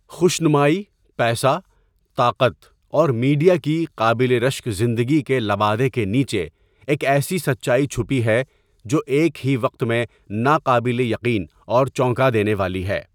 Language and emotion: Urdu, neutral